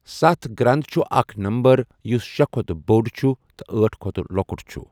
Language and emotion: Kashmiri, neutral